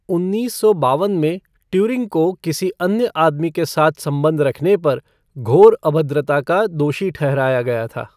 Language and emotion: Hindi, neutral